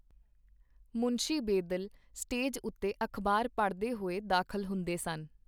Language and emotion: Punjabi, neutral